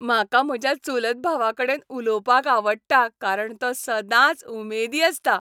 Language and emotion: Goan Konkani, happy